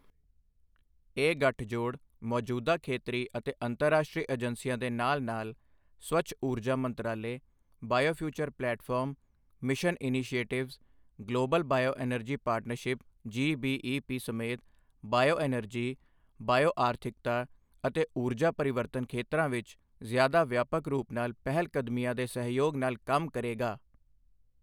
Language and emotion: Punjabi, neutral